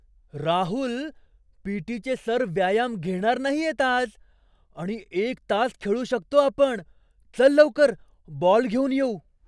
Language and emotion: Marathi, surprised